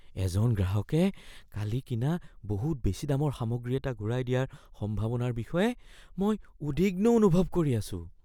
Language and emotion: Assamese, fearful